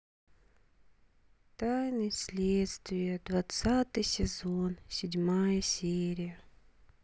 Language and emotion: Russian, sad